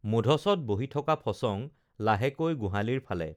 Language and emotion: Assamese, neutral